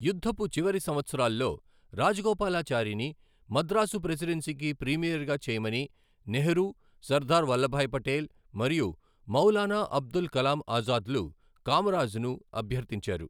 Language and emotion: Telugu, neutral